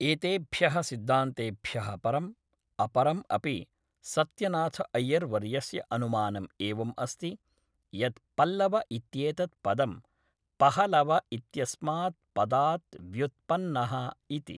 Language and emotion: Sanskrit, neutral